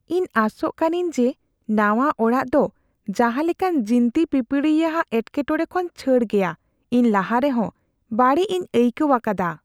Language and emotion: Santali, fearful